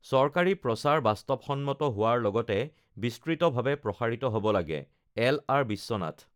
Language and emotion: Assamese, neutral